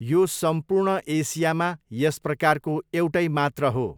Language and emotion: Nepali, neutral